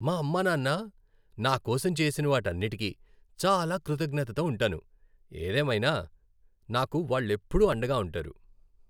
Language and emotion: Telugu, happy